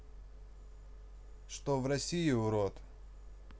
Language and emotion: Russian, neutral